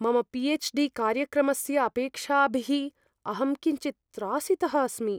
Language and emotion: Sanskrit, fearful